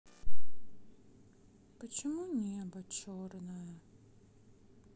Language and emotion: Russian, sad